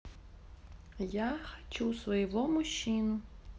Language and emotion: Russian, neutral